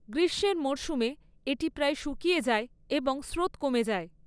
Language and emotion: Bengali, neutral